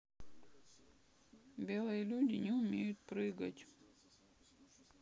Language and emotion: Russian, sad